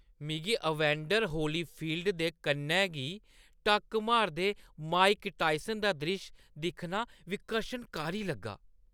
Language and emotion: Dogri, disgusted